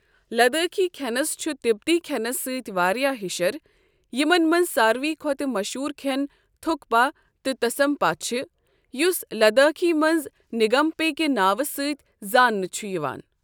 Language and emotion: Kashmiri, neutral